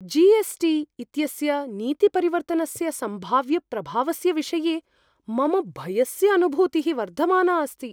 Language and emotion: Sanskrit, fearful